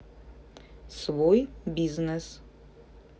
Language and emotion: Russian, neutral